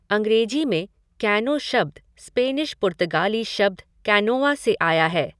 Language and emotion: Hindi, neutral